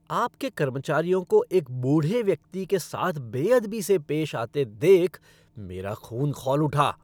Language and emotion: Hindi, angry